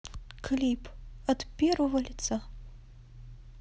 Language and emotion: Russian, sad